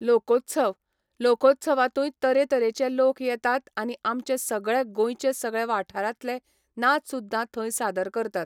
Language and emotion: Goan Konkani, neutral